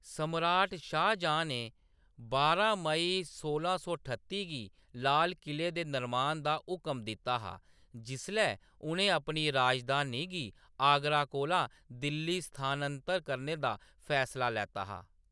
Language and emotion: Dogri, neutral